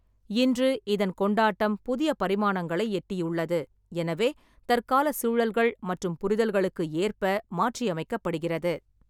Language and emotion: Tamil, neutral